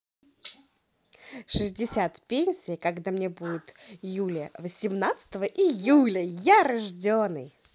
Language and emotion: Russian, positive